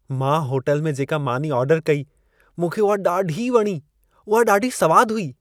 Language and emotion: Sindhi, happy